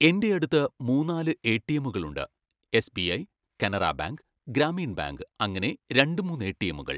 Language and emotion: Malayalam, neutral